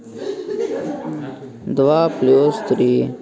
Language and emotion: Russian, neutral